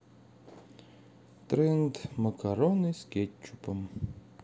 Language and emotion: Russian, sad